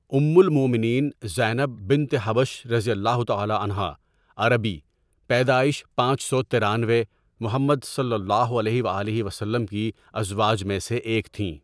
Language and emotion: Urdu, neutral